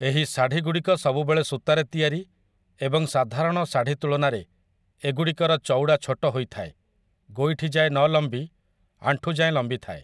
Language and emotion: Odia, neutral